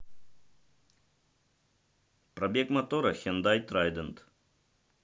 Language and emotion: Russian, neutral